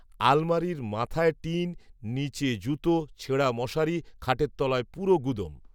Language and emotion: Bengali, neutral